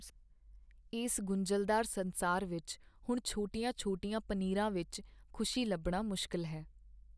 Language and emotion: Punjabi, sad